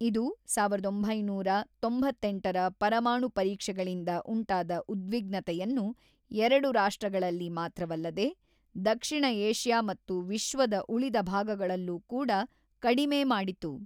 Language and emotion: Kannada, neutral